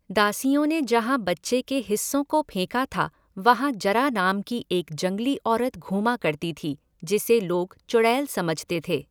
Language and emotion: Hindi, neutral